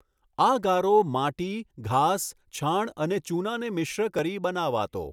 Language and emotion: Gujarati, neutral